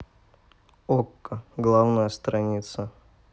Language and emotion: Russian, neutral